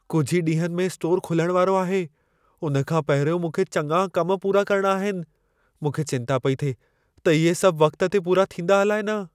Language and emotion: Sindhi, fearful